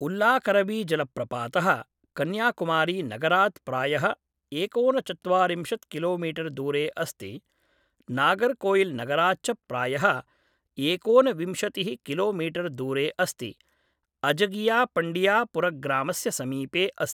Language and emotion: Sanskrit, neutral